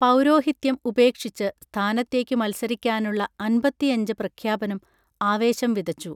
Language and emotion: Malayalam, neutral